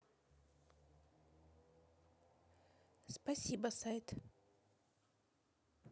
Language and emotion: Russian, neutral